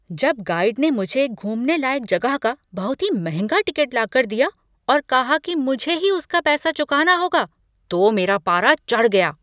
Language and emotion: Hindi, angry